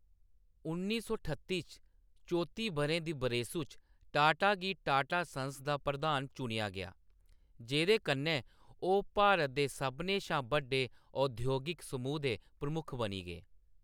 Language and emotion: Dogri, neutral